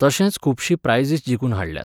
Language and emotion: Goan Konkani, neutral